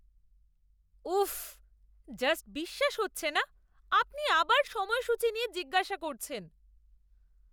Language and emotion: Bengali, disgusted